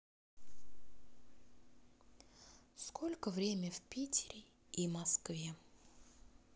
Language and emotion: Russian, sad